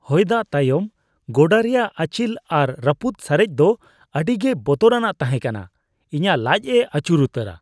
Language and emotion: Santali, disgusted